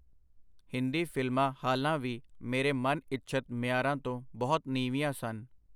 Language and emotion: Punjabi, neutral